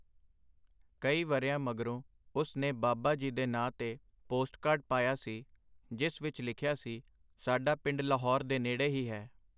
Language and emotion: Punjabi, neutral